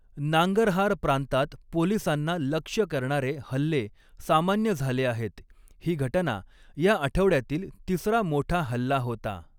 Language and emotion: Marathi, neutral